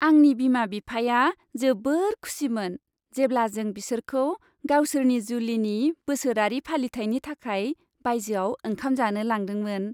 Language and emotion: Bodo, happy